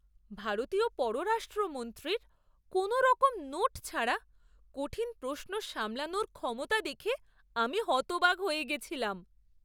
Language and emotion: Bengali, surprised